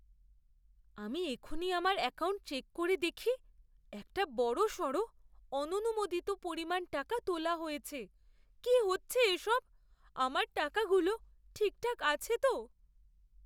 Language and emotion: Bengali, fearful